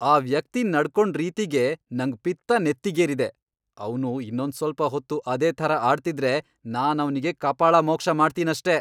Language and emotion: Kannada, angry